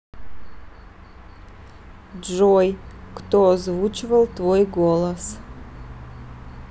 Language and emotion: Russian, neutral